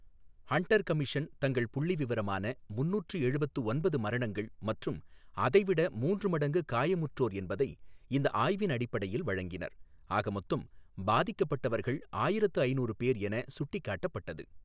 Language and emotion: Tamil, neutral